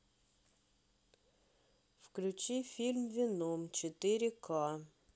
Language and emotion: Russian, neutral